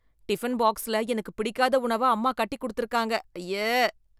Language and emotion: Tamil, disgusted